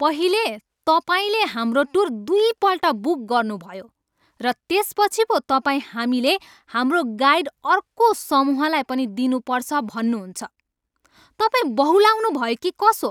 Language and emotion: Nepali, angry